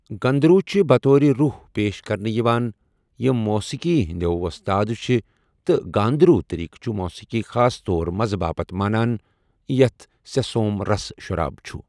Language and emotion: Kashmiri, neutral